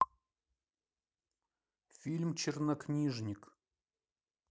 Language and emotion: Russian, neutral